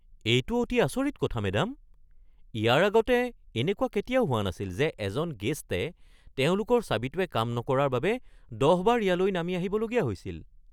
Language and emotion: Assamese, surprised